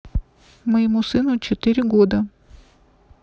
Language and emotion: Russian, neutral